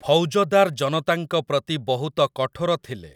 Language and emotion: Odia, neutral